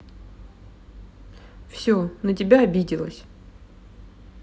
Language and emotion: Russian, sad